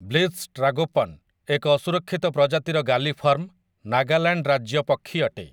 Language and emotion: Odia, neutral